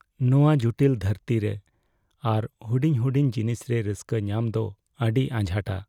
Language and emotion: Santali, sad